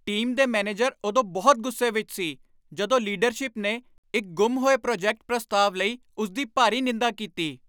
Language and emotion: Punjabi, angry